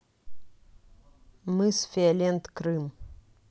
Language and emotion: Russian, neutral